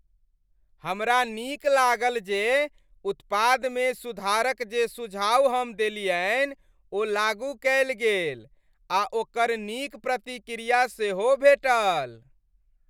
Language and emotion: Maithili, happy